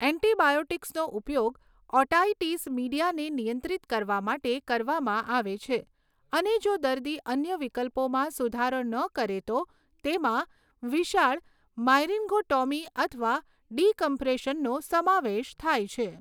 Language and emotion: Gujarati, neutral